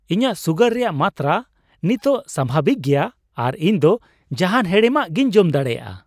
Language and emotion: Santali, happy